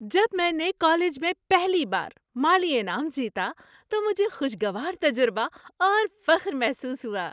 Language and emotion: Urdu, happy